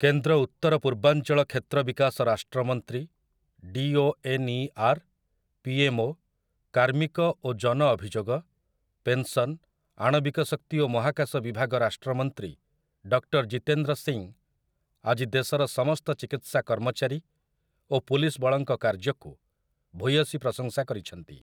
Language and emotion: Odia, neutral